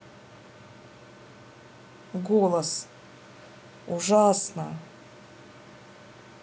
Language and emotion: Russian, neutral